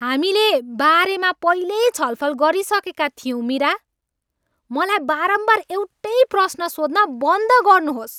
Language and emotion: Nepali, angry